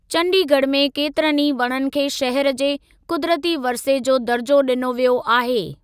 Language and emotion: Sindhi, neutral